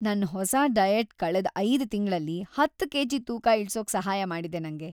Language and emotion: Kannada, happy